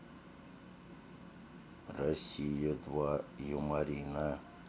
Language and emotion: Russian, neutral